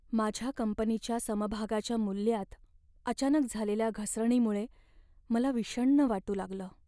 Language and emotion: Marathi, sad